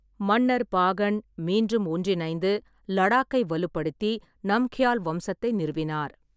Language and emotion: Tamil, neutral